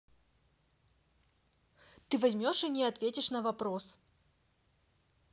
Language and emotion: Russian, angry